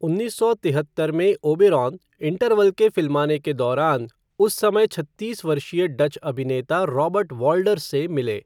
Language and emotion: Hindi, neutral